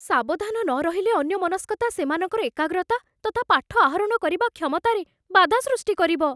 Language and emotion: Odia, fearful